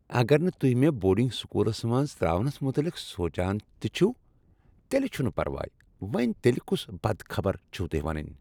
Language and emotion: Kashmiri, happy